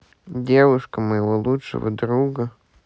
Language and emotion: Russian, sad